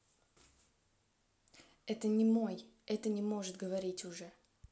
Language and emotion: Russian, neutral